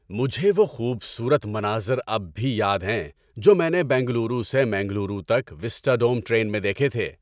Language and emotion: Urdu, happy